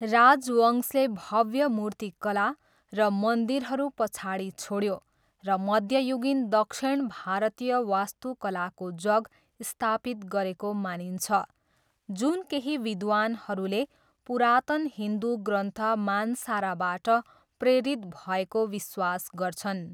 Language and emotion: Nepali, neutral